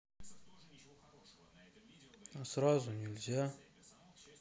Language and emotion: Russian, neutral